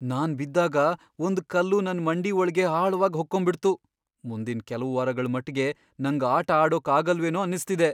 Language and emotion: Kannada, fearful